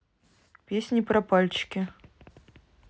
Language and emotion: Russian, neutral